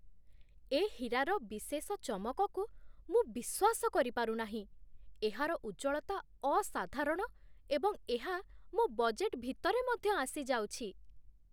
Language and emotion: Odia, surprised